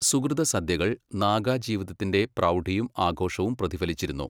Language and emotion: Malayalam, neutral